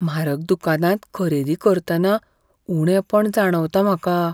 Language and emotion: Goan Konkani, fearful